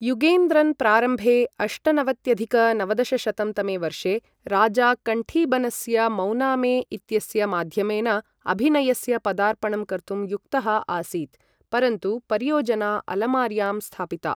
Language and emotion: Sanskrit, neutral